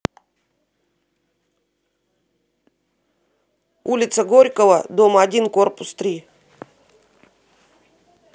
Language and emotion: Russian, neutral